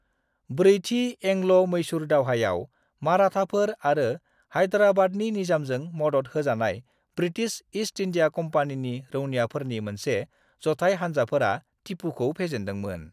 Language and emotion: Bodo, neutral